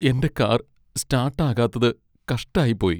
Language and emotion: Malayalam, sad